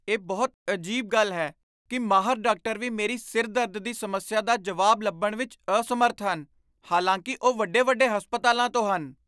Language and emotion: Punjabi, surprised